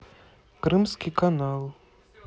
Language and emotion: Russian, neutral